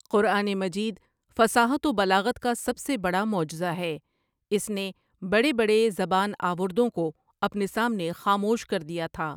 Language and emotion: Urdu, neutral